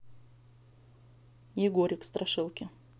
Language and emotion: Russian, neutral